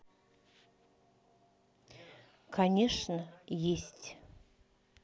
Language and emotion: Russian, neutral